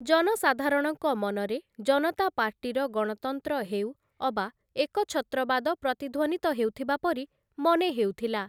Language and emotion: Odia, neutral